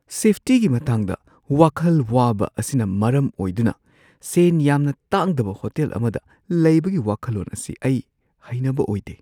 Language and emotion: Manipuri, fearful